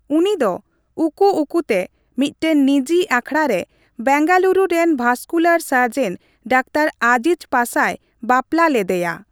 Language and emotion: Santali, neutral